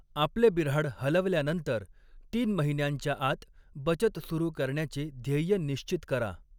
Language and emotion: Marathi, neutral